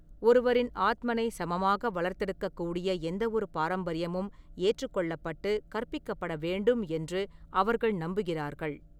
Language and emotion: Tamil, neutral